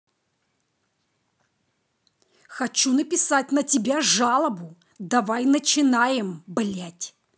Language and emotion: Russian, angry